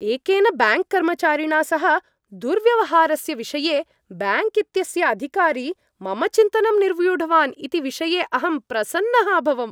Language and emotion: Sanskrit, happy